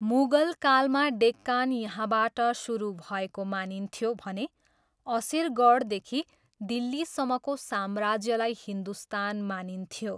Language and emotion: Nepali, neutral